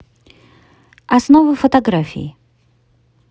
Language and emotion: Russian, neutral